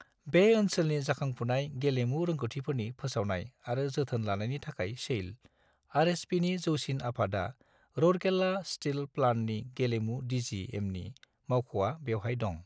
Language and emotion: Bodo, neutral